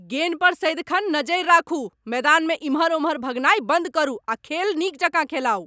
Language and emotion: Maithili, angry